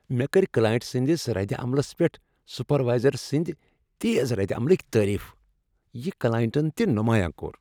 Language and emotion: Kashmiri, happy